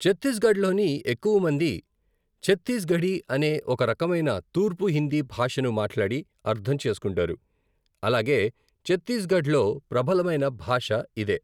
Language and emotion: Telugu, neutral